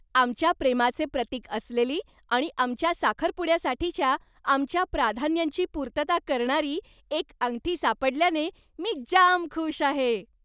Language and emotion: Marathi, happy